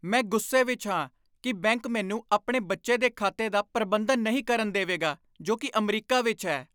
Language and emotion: Punjabi, angry